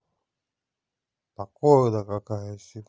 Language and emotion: Russian, neutral